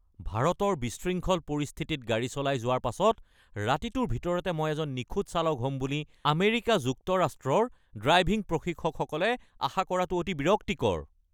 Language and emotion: Assamese, angry